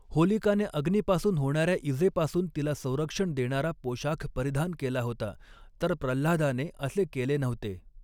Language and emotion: Marathi, neutral